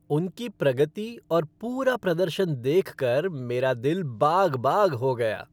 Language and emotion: Hindi, happy